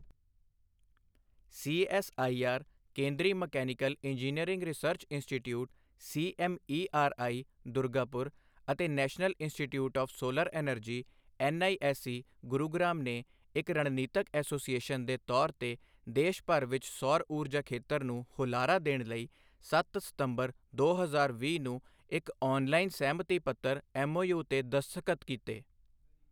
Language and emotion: Punjabi, neutral